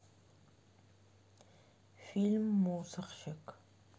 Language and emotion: Russian, neutral